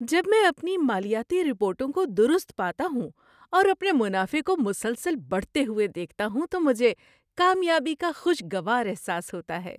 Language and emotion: Urdu, happy